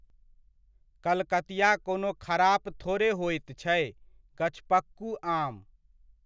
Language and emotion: Maithili, neutral